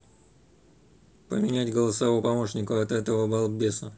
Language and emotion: Russian, angry